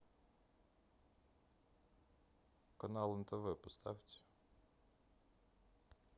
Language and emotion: Russian, neutral